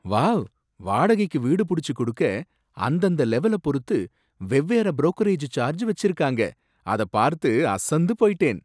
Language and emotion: Tamil, surprised